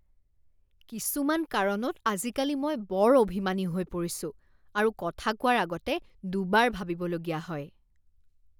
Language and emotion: Assamese, disgusted